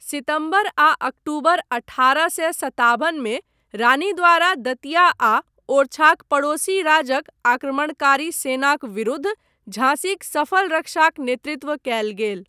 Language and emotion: Maithili, neutral